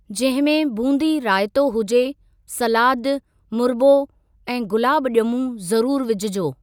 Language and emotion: Sindhi, neutral